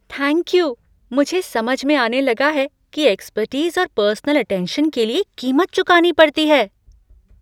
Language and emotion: Hindi, surprised